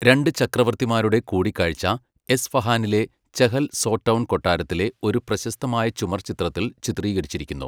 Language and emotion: Malayalam, neutral